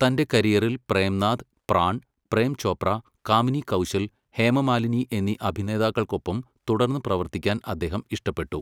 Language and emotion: Malayalam, neutral